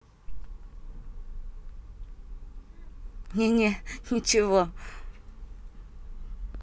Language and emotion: Russian, positive